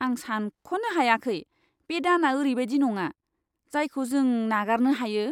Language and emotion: Bodo, disgusted